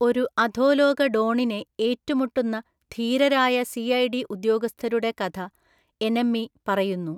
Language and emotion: Malayalam, neutral